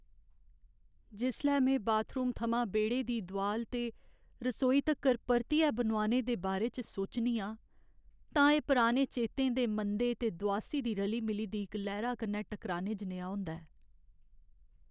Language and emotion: Dogri, sad